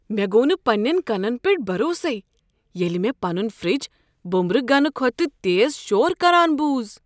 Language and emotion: Kashmiri, surprised